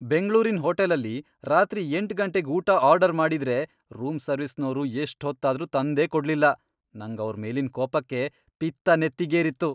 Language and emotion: Kannada, angry